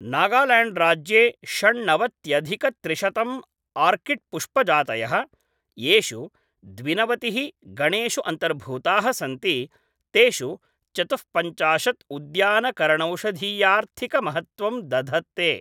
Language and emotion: Sanskrit, neutral